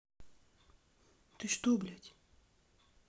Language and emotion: Russian, angry